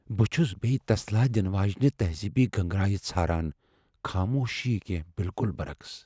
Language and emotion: Kashmiri, fearful